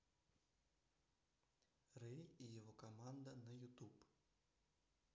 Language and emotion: Russian, neutral